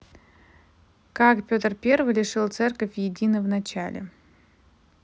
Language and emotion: Russian, neutral